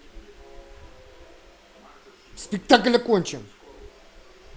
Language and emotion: Russian, angry